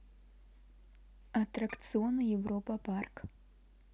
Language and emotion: Russian, neutral